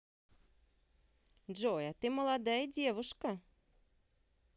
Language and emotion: Russian, positive